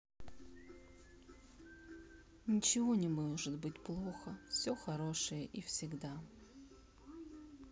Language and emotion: Russian, sad